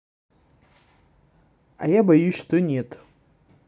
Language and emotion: Russian, neutral